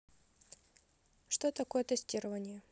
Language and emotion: Russian, neutral